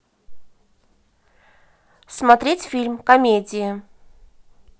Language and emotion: Russian, neutral